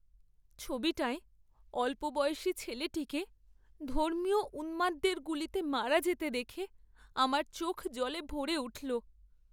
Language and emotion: Bengali, sad